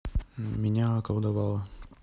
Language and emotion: Russian, neutral